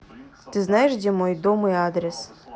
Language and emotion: Russian, neutral